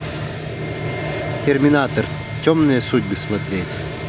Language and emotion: Russian, neutral